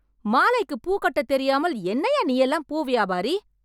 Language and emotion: Tamil, angry